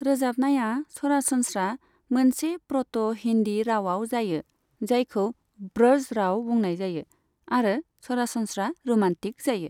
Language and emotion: Bodo, neutral